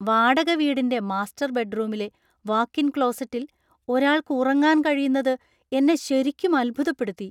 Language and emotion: Malayalam, surprised